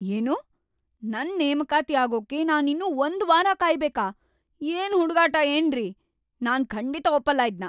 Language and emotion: Kannada, angry